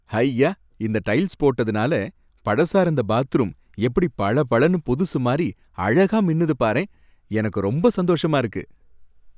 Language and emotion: Tamil, happy